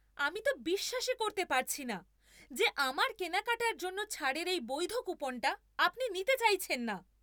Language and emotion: Bengali, angry